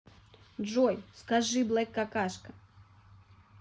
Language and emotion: Russian, neutral